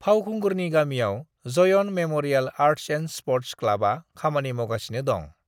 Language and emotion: Bodo, neutral